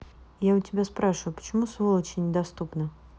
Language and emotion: Russian, angry